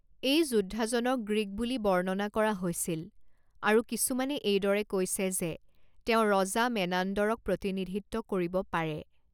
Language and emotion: Assamese, neutral